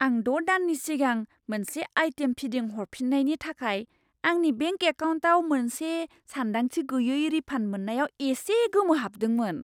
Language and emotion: Bodo, surprised